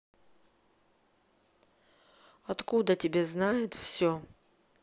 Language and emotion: Russian, neutral